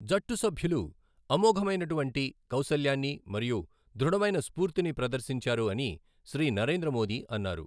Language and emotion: Telugu, neutral